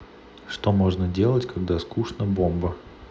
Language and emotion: Russian, neutral